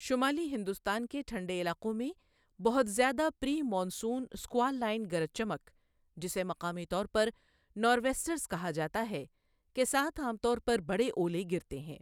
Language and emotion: Urdu, neutral